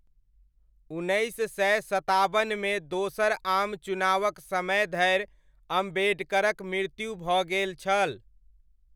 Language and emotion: Maithili, neutral